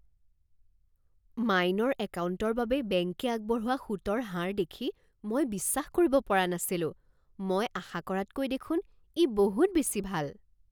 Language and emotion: Assamese, surprised